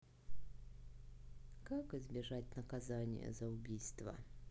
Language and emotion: Russian, sad